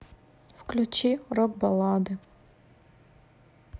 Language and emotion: Russian, sad